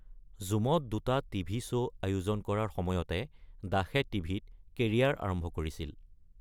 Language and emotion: Assamese, neutral